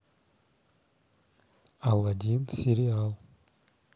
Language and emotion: Russian, neutral